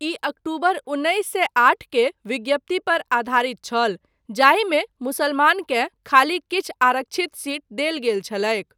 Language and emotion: Maithili, neutral